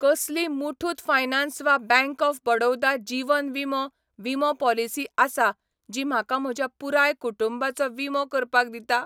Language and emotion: Goan Konkani, neutral